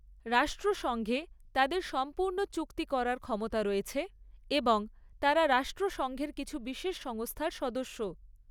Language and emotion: Bengali, neutral